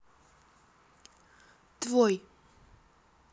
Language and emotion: Russian, neutral